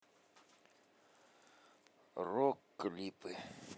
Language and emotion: Russian, neutral